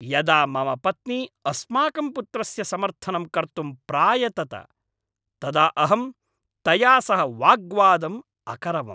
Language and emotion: Sanskrit, angry